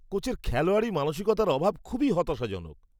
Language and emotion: Bengali, disgusted